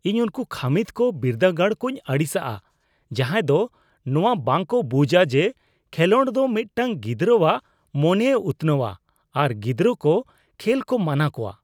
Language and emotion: Santali, disgusted